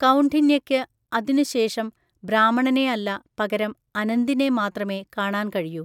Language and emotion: Malayalam, neutral